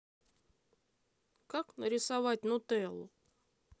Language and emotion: Russian, neutral